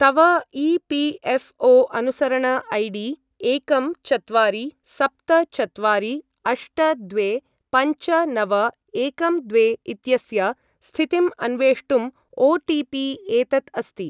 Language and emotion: Sanskrit, neutral